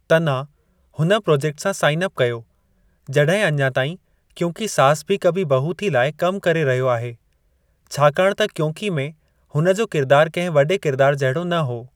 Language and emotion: Sindhi, neutral